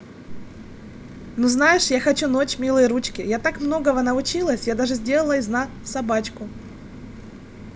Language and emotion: Russian, positive